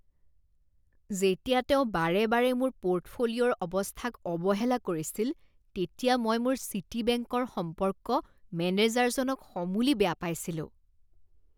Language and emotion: Assamese, disgusted